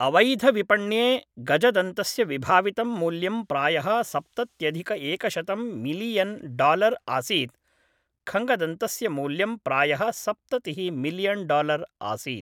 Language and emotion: Sanskrit, neutral